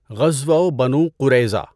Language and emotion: Urdu, neutral